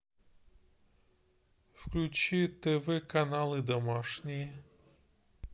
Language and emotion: Russian, neutral